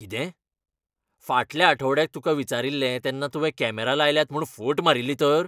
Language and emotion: Goan Konkani, angry